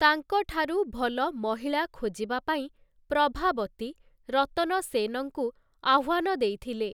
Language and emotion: Odia, neutral